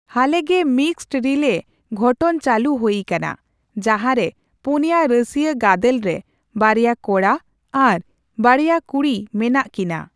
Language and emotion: Santali, neutral